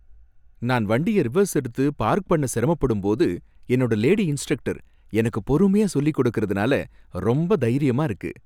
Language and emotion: Tamil, happy